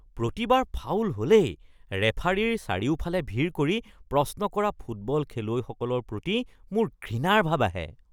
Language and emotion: Assamese, disgusted